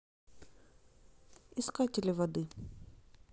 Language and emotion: Russian, neutral